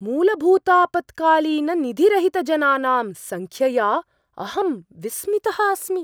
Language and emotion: Sanskrit, surprised